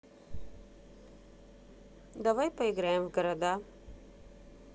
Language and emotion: Russian, neutral